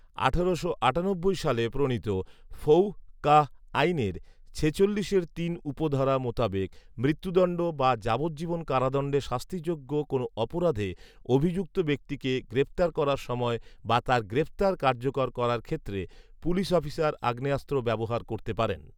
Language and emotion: Bengali, neutral